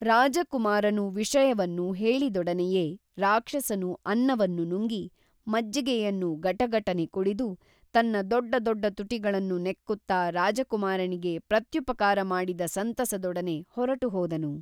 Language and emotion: Kannada, neutral